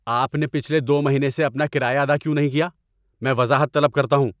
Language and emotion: Urdu, angry